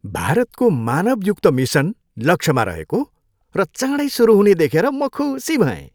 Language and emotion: Nepali, happy